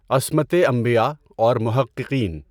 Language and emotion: Urdu, neutral